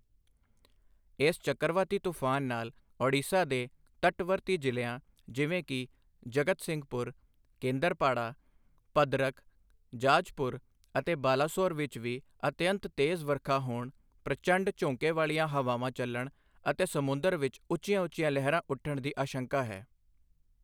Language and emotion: Punjabi, neutral